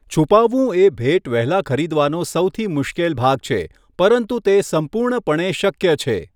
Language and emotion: Gujarati, neutral